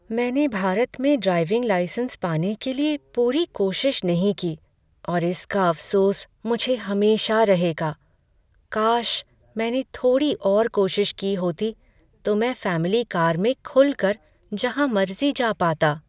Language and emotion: Hindi, sad